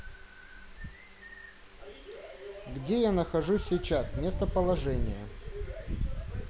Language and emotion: Russian, neutral